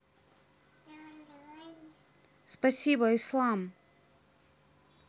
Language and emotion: Russian, neutral